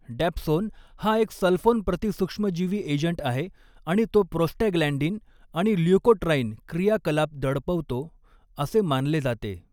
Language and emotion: Marathi, neutral